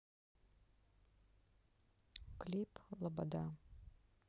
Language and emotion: Russian, neutral